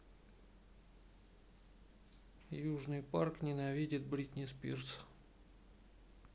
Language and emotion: Russian, neutral